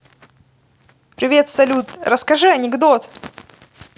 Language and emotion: Russian, positive